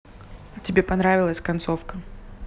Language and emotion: Russian, neutral